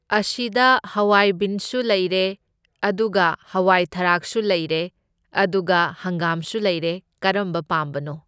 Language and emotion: Manipuri, neutral